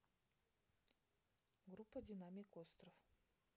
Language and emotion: Russian, neutral